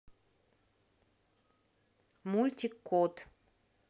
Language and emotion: Russian, neutral